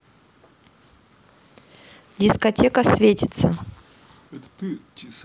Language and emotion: Russian, neutral